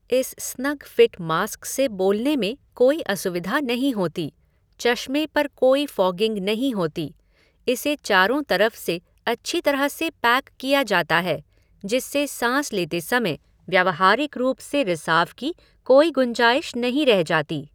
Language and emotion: Hindi, neutral